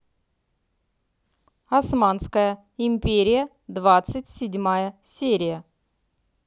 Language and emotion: Russian, neutral